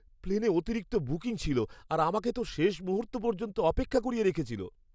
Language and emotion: Bengali, fearful